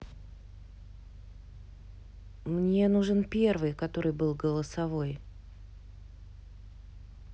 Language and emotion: Russian, neutral